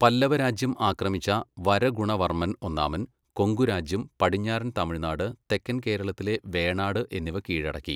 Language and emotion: Malayalam, neutral